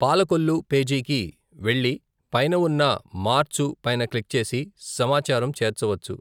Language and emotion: Telugu, neutral